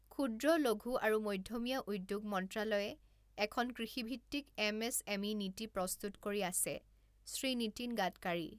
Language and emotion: Assamese, neutral